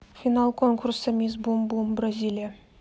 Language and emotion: Russian, neutral